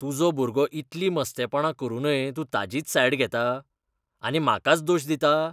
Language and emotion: Goan Konkani, disgusted